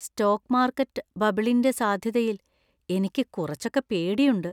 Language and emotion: Malayalam, fearful